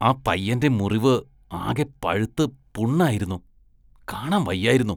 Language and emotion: Malayalam, disgusted